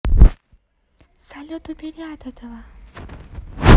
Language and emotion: Russian, positive